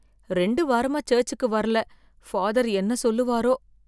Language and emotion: Tamil, fearful